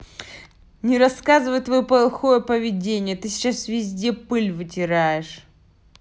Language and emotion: Russian, angry